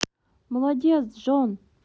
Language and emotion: Russian, positive